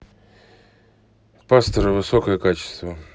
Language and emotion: Russian, neutral